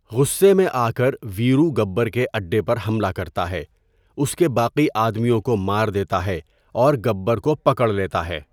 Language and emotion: Urdu, neutral